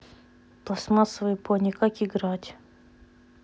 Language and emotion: Russian, neutral